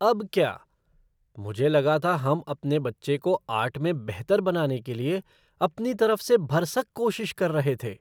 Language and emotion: Hindi, surprised